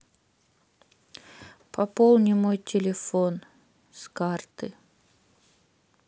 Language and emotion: Russian, sad